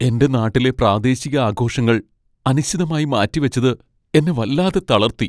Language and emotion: Malayalam, sad